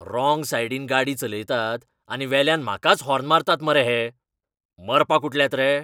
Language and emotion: Goan Konkani, angry